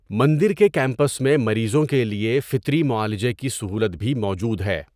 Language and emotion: Urdu, neutral